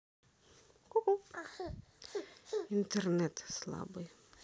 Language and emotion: Russian, sad